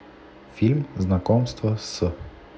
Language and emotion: Russian, neutral